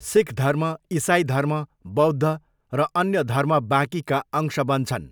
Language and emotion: Nepali, neutral